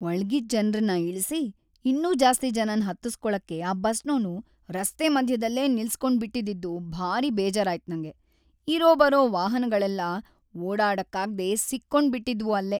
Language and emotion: Kannada, sad